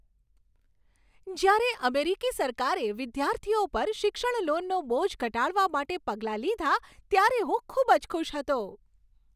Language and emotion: Gujarati, happy